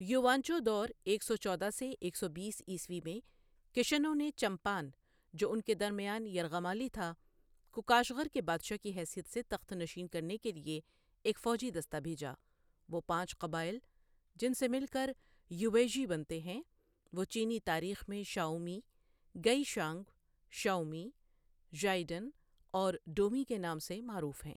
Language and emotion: Urdu, neutral